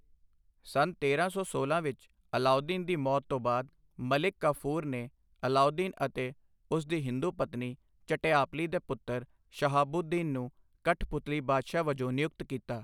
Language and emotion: Punjabi, neutral